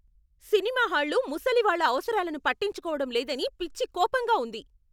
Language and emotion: Telugu, angry